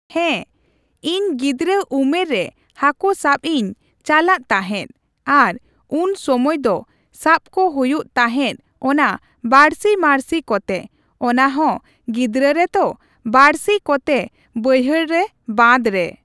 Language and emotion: Santali, neutral